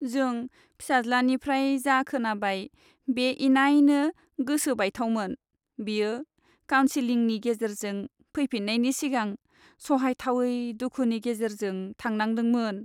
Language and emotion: Bodo, sad